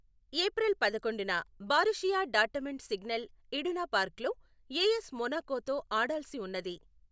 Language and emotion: Telugu, neutral